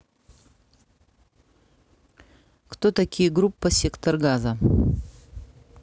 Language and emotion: Russian, neutral